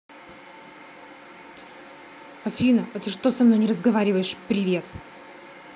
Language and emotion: Russian, angry